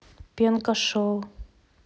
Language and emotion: Russian, neutral